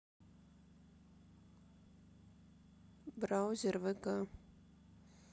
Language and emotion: Russian, neutral